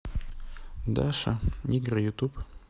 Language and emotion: Russian, neutral